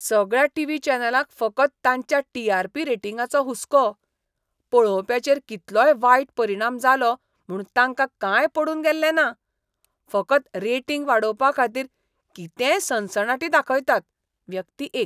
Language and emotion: Goan Konkani, disgusted